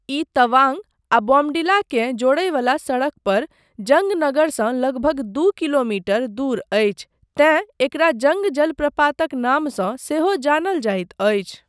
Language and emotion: Maithili, neutral